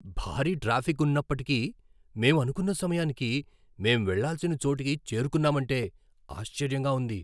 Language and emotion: Telugu, surprised